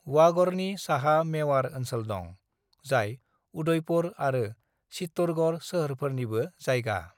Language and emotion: Bodo, neutral